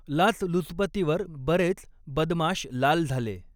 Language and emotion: Marathi, neutral